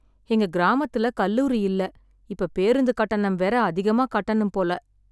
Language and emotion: Tamil, sad